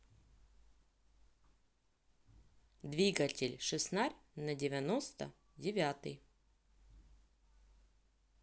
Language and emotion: Russian, neutral